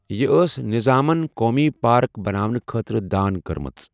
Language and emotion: Kashmiri, neutral